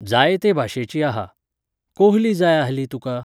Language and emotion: Goan Konkani, neutral